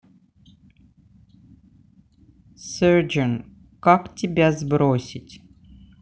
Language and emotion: Russian, neutral